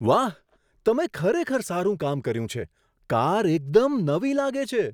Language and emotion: Gujarati, surprised